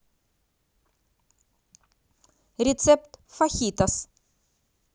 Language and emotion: Russian, positive